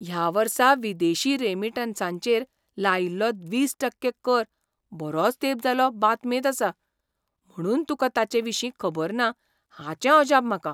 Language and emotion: Goan Konkani, surprised